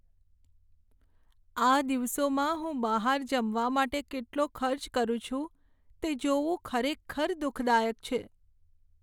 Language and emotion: Gujarati, sad